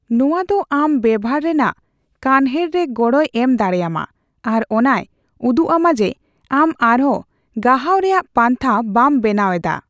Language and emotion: Santali, neutral